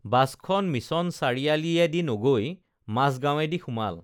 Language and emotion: Assamese, neutral